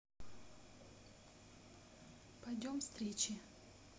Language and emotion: Russian, neutral